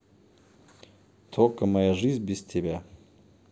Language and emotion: Russian, neutral